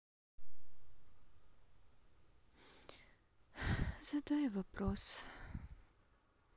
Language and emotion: Russian, sad